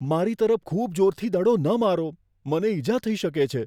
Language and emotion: Gujarati, fearful